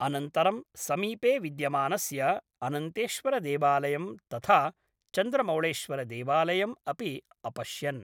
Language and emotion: Sanskrit, neutral